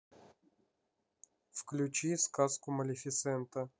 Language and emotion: Russian, neutral